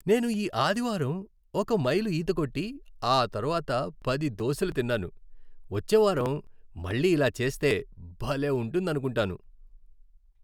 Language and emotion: Telugu, happy